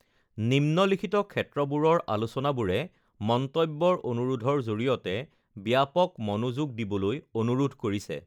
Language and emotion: Assamese, neutral